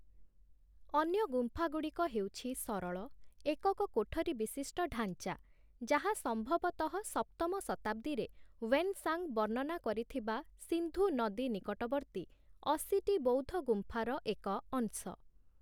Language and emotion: Odia, neutral